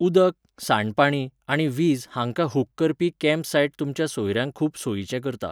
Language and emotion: Goan Konkani, neutral